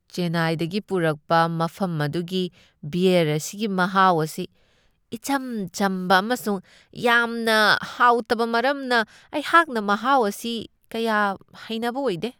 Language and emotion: Manipuri, disgusted